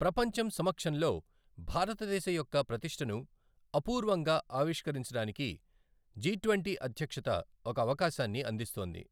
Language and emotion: Telugu, neutral